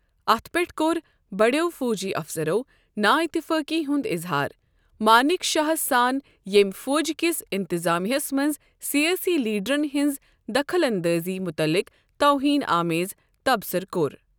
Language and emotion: Kashmiri, neutral